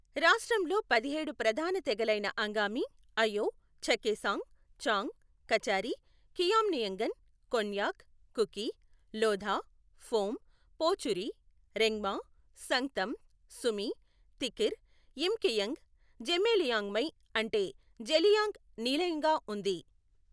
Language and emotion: Telugu, neutral